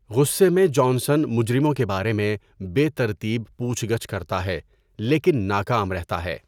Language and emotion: Urdu, neutral